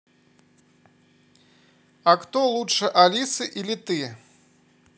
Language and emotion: Russian, positive